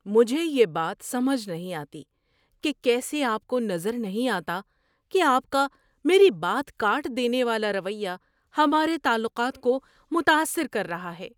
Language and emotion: Urdu, surprised